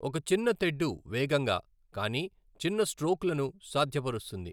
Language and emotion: Telugu, neutral